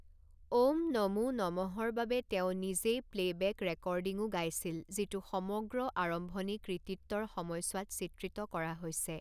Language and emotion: Assamese, neutral